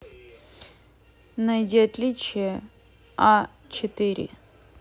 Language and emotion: Russian, neutral